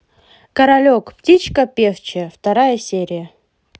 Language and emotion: Russian, positive